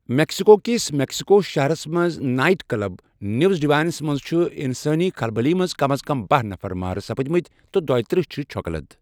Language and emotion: Kashmiri, neutral